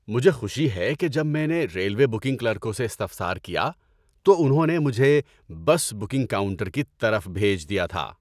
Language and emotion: Urdu, happy